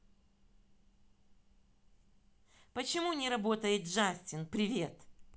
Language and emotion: Russian, angry